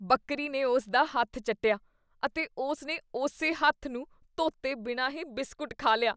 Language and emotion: Punjabi, disgusted